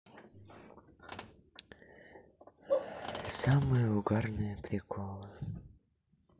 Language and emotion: Russian, sad